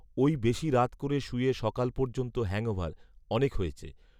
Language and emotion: Bengali, neutral